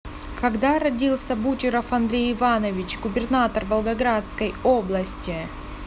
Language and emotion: Russian, neutral